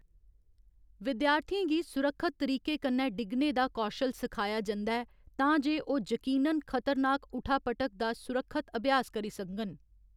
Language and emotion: Dogri, neutral